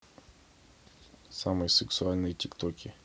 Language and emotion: Russian, neutral